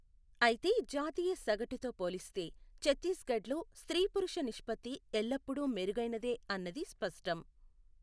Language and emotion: Telugu, neutral